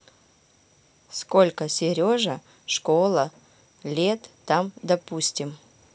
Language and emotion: Russian, neutral